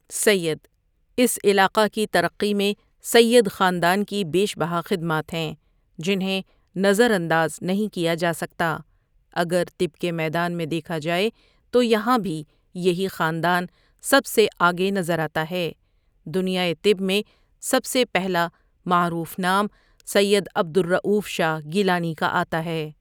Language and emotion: Urdu, neutral